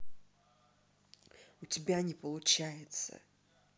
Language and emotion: Russian, angry